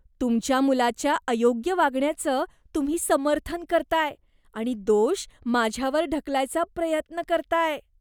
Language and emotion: Marathi, disgusted